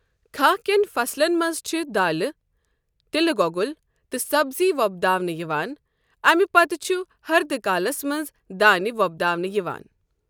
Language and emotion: Kashmiri, neutral